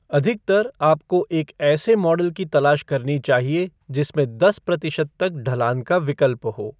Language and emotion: Hindi, neutral